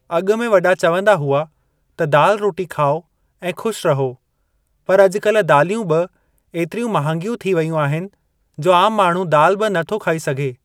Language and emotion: Sindhi, neutral